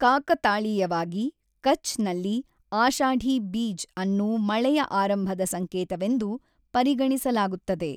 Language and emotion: Kannada, neutral